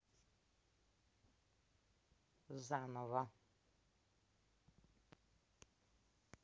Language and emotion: Russian, neutral